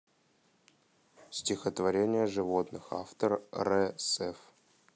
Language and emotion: Russian, neutral